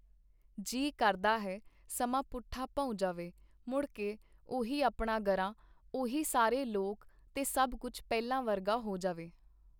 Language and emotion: Punjabi, neutral